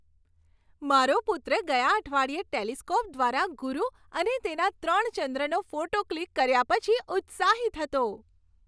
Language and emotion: Gujarati, happy